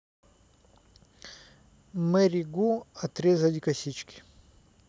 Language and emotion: Russian, neutral